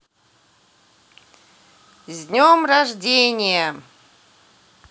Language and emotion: Russian, positive